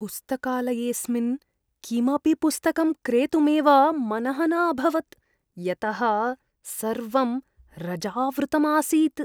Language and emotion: Sanskrit, disgusted